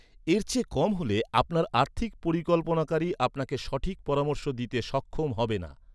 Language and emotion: Bengali, neutral